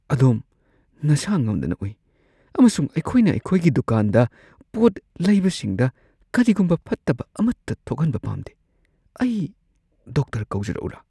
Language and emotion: Manipuri, fearful